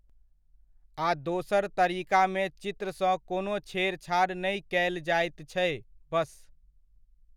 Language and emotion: Maithili, neutral